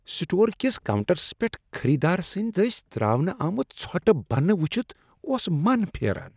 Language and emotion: Kashmiri, disgusted